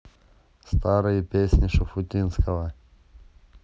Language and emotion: Russian, neutral